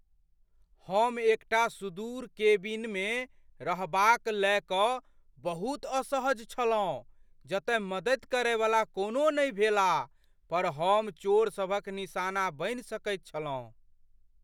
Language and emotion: Maithili, fearful